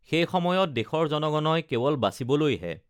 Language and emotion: Assamese, neutral